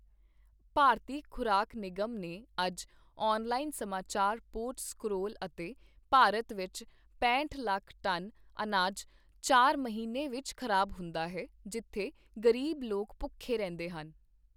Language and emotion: Punjabi, neutral